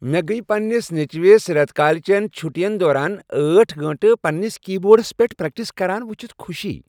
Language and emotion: Kashmiri, happy